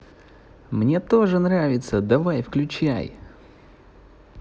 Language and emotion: Russian, positive